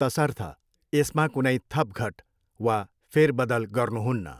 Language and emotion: Nepali, neutral